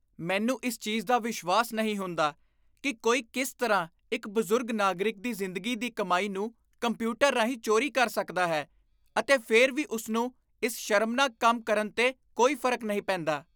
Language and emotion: Punjabi, disgusted